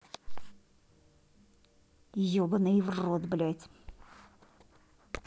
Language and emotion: Russian, angry